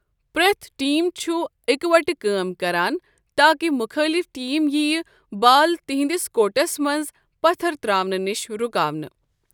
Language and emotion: Kashmiri, neutral